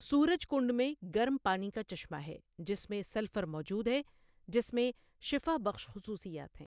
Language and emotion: Urdu, neutral